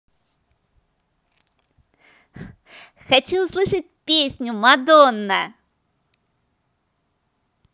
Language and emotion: Russian, positive